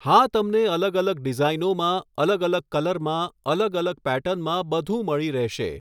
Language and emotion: Gujarati, neutral